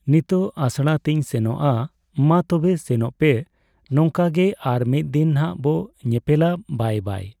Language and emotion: Santali, neutral